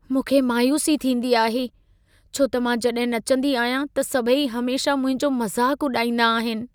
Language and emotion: Sindhi, sad